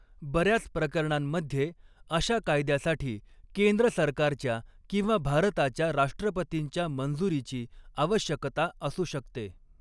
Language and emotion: Marathi, neutral